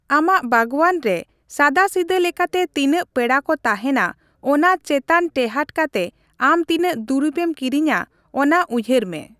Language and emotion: Santali, neutral